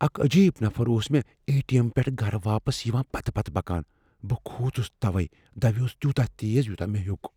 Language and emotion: Kashmiri, fearful